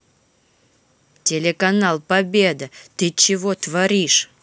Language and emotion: Russian, angry